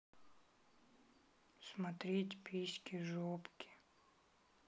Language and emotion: Russian, sad